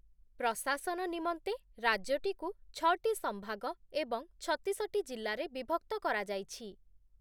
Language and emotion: Odia, neutral